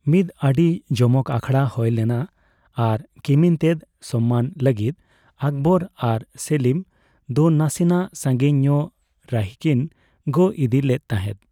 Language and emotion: Santali, neutral